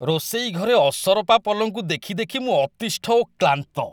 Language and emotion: Odia, disgusted